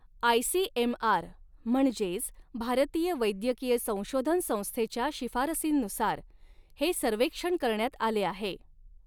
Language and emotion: Marathi, neutral